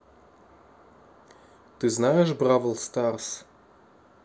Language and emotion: Russian, neutral